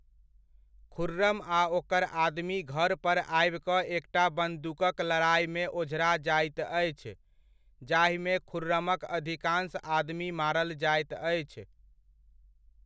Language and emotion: Maithili, neutral